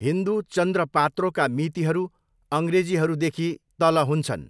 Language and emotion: Nepali, neutral